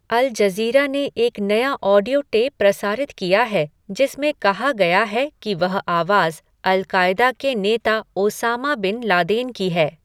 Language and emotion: Hindi, neutral